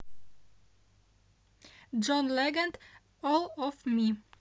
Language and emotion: Russian, neutral